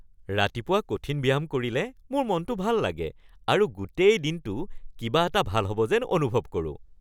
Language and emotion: Assamese, happy